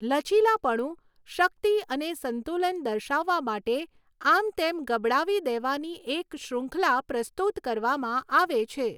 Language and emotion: Gujarati, neutral